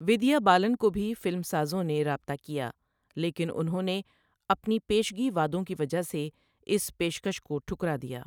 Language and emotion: Urdu, neutral